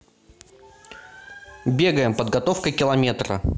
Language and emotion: Russian, neutral